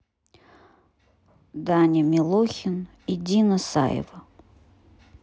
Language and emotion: Russian, neutral